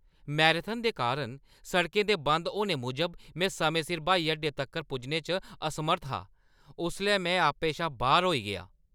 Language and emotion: Dogri, angry